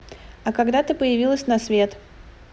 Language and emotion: Russian, neutral